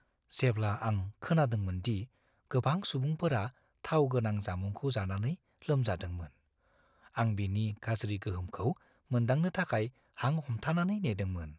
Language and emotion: Bodo, fearful